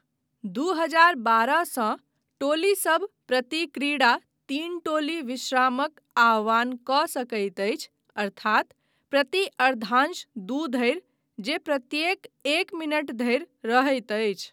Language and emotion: Maithili, neutral